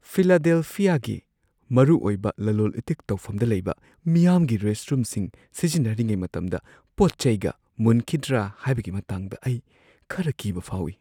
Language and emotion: Manipuri, fearful